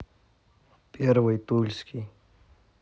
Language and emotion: Russian, neutral